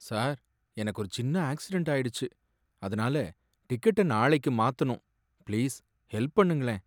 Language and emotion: Tamil, sad